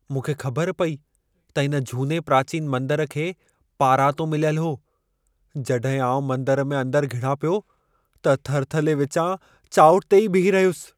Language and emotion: Sindhi, fearful